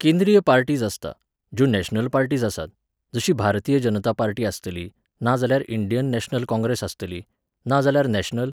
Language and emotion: Goan Konkani, neutral